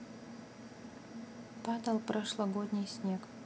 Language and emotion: Russian, neutral